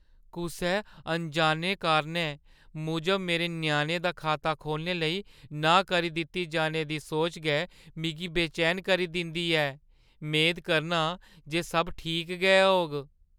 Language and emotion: Dogri, fearful